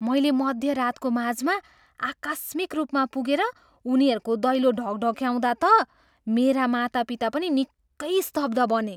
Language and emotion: Nepali, surprised